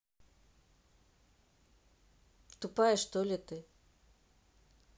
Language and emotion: Russian, angry